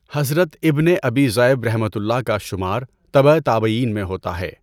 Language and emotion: Urdu, neutral